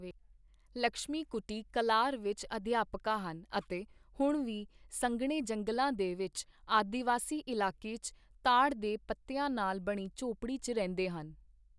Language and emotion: Punjabi, neutral